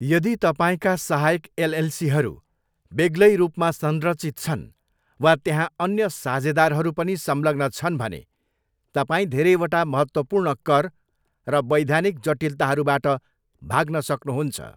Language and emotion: Nepali, neutral